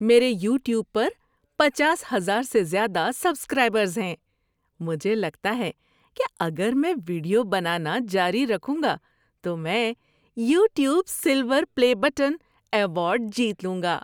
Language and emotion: Urdu, happy